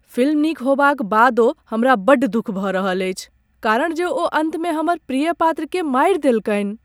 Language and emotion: Maithili, sad